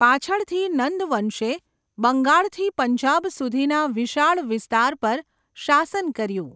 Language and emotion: Gujarati, neutral